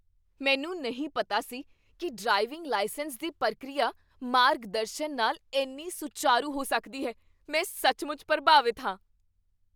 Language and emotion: Punjabi, surprised